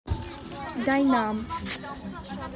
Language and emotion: Russian, neutral